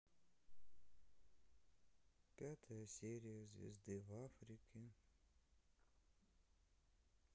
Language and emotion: Russian, sad